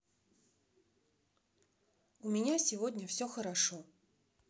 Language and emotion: Russian, neutral